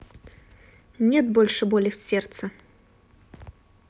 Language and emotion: Russian, neutral